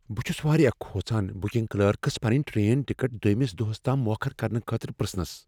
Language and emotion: Kashmiri, fearful